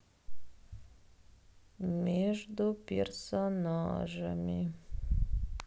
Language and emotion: Russian, sad